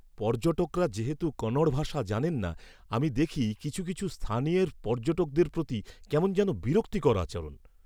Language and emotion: Bengali, disgusted